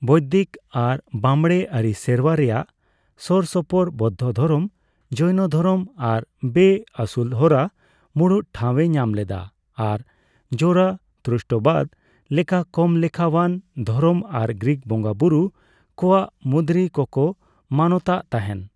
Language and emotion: Santali, neutral